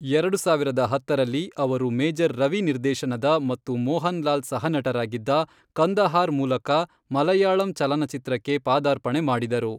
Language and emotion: Kannada, neutral